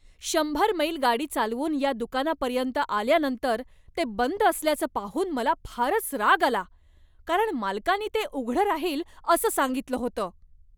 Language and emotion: Marathi, angry